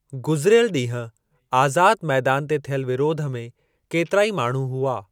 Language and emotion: Sindhi, neutral